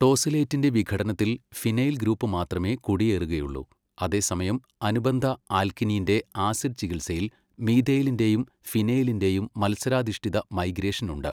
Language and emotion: Malayalam, neutral